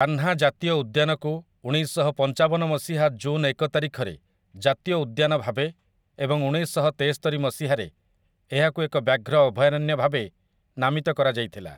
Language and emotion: Odia, neutral